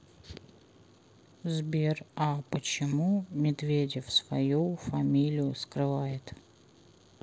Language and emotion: Russian, neutral